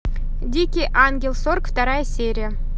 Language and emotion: Russian, neutral